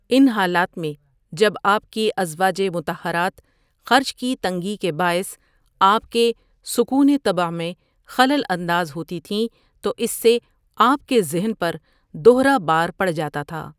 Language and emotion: Urdu, neutral